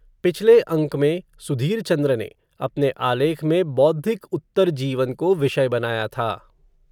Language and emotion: Hindi, neutral